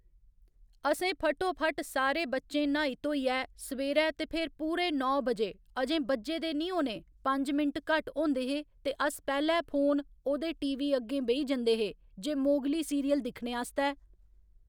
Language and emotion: Dogri, neutral